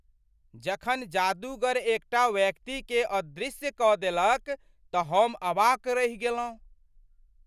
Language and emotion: Maithili, surprised